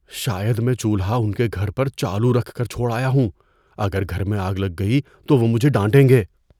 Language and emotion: Urdu, fearful